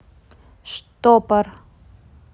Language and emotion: Russian, neutral